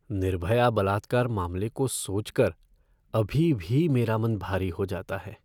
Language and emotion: Hindi, sad